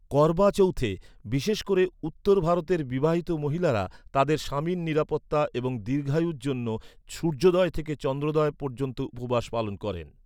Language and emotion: Bengali, neutral